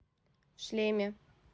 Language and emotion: Russian, neutral